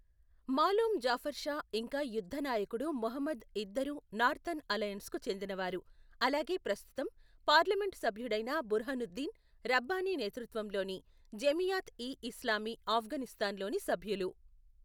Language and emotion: Telugu, neutral